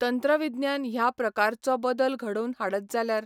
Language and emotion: Goan Konkani, neutral